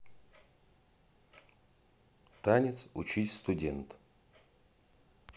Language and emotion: Russian, neutral